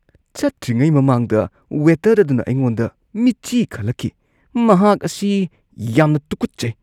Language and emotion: Manipuri, disgusted